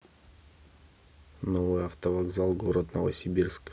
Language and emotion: Russian, neutral